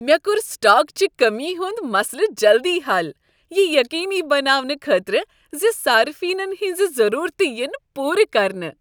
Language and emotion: Kashmiri, happy